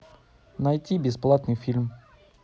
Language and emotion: Russian, neutral